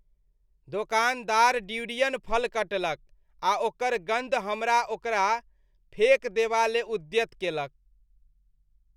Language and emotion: Maithili, disgusted